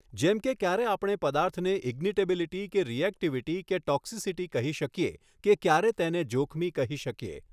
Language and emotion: Gujarati, neutral